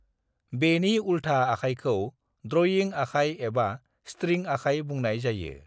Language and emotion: Bodo, neutral